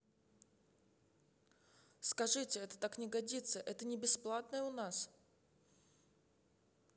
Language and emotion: Russian, neutral